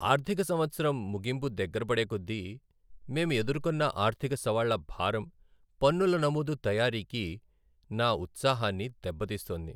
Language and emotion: Telugu, sad